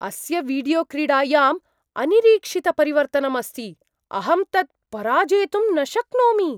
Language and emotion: Sanskrit, surprised